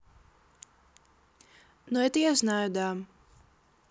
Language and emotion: Russian, neutral